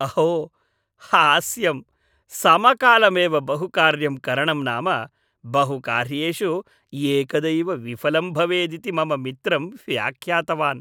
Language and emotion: Sanskrit, happy